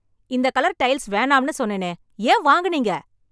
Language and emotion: Tamil, angry